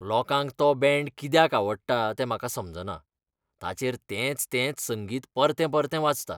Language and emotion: Goan Konkani, disgusted